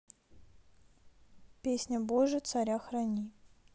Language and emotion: Russian, neutral